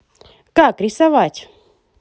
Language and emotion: Russian, positive